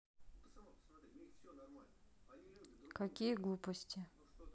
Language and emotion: Russian, neutral